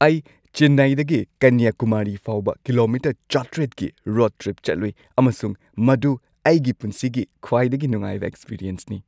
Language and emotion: Manipuri, happy